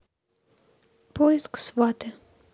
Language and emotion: Russian, neutral